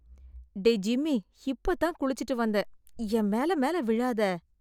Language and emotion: Tamil, disgusted